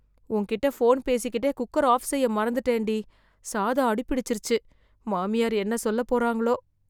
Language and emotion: Tamil, fearful